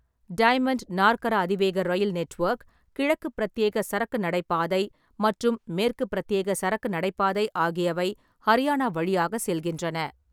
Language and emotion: Tamil, neutral